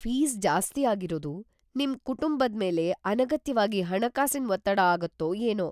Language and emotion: Kannada, fearful